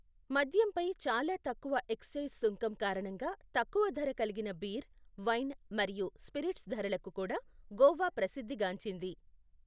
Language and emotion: Telugu, neutral